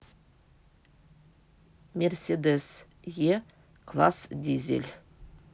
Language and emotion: Russian, neutral